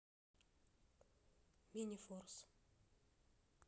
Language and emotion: Russian, neutral